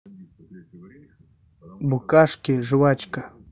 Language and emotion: Russian, neutral